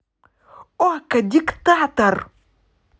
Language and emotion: Russian, positive